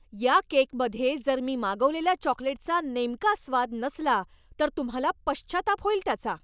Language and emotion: Marathi, angry